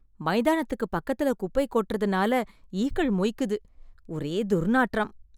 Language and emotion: Tamil, disgusted